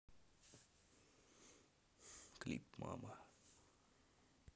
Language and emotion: Russian, neutral